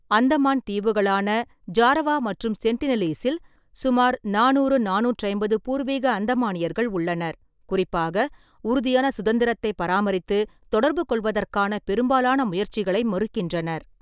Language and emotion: Tamil, neutral